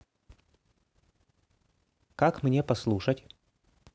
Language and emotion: Russian, neutral